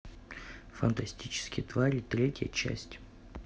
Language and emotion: Russian, neutral